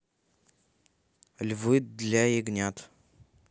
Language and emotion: Russian, neutral